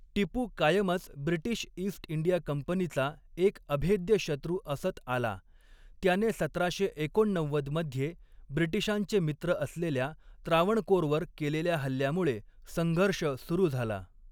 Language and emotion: Marathi, neutral